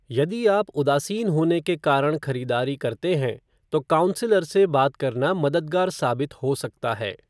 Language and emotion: Hindi, neutral